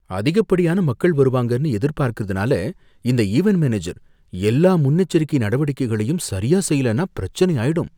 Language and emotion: Tamil, fearful